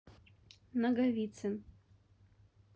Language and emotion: Russian, neutral